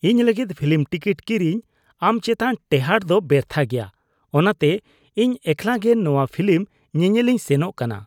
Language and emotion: Santali, disgusted